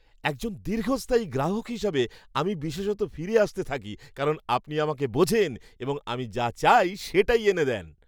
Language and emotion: Bengali, happy